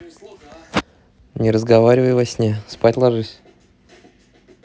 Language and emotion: Russian, neutral